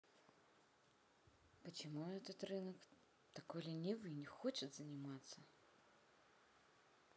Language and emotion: Russian, sad